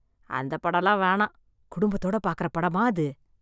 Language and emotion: Tamil, disgusted